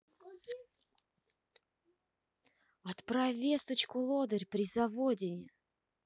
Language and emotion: Russian, angry